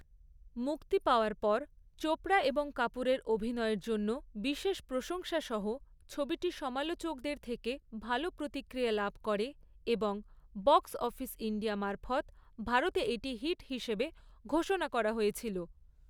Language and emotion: Bengali, neutral